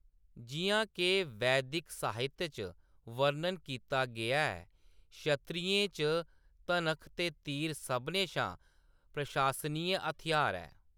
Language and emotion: Dogri, neutral